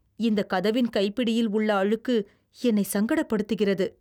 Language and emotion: Tamil, disgusted